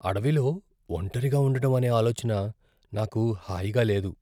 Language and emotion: Telugu, fearful